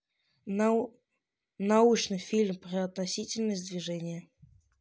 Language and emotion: Russian, neutral